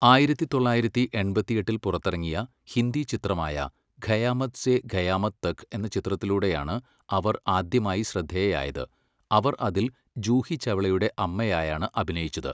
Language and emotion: Malayalam, neutral